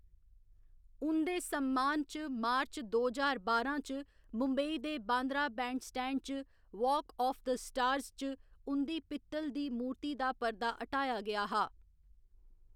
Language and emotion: Dogri, neutral